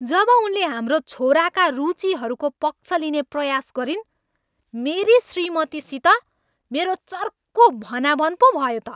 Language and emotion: Nepali, angry